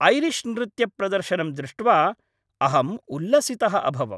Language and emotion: Sanskrit, happy